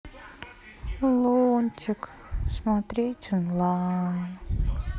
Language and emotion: Russian, sad